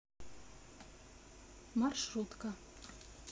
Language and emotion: Russian, neutral